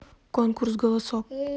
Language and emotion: Russian, neutral